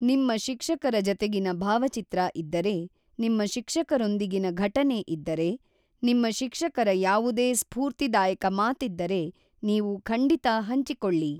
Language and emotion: Kannada, neutral